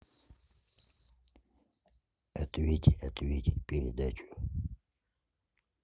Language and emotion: Russian, neutral